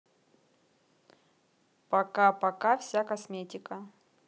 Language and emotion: Russian, neutral